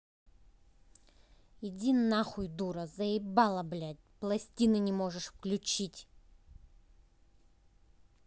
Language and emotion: Russian, angry